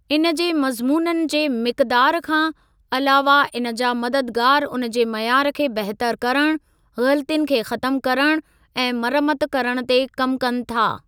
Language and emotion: Sindhi, neutral